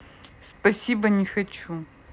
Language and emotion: Russian, neutral